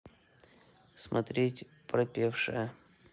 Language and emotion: Russian, neutral